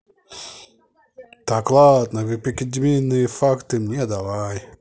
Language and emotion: Russian, neutral